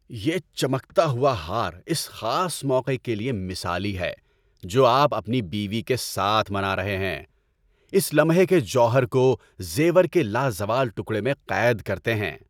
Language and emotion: Urdu, happy